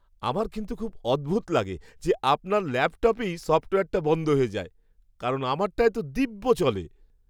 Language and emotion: Bengali, surprised